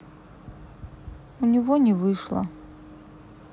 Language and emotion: Russian, sad